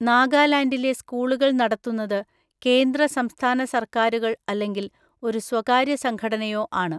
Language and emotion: Malayalam, neutral